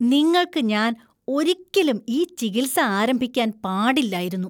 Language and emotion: Malayalam, disgusted